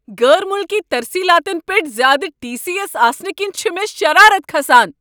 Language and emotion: Kashmiri, angry